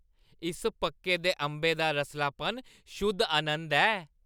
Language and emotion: Dogri, happy